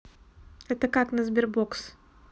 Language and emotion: Russian, neutral